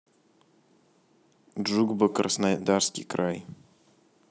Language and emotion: Russian, neutral